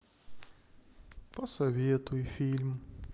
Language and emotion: Russian, sad